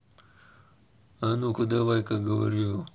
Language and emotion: Russian, angry